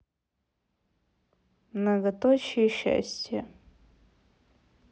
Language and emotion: Russian, neutral